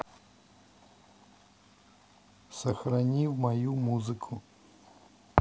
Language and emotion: Russian, neutral